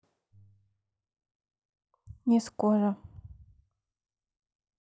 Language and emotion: Russian, sad